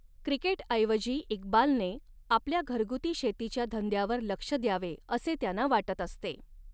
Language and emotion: Marathi, neutral